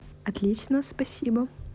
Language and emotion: Russian, positive